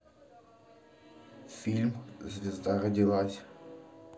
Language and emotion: Russian, neutral